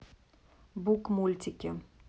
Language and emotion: Russian, neutral